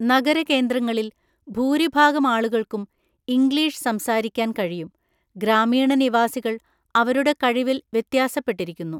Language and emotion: Malayalam, neutral